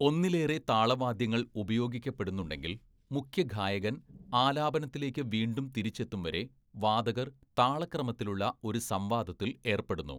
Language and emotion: Malayalam, neutral